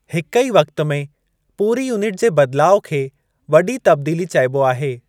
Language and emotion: Sindhi, neutral